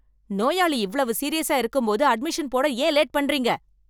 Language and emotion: Tamil, angry